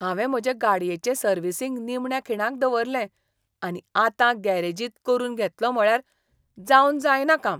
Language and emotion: Goan Konkani, disgusted